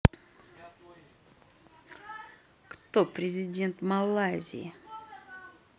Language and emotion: Russian, angry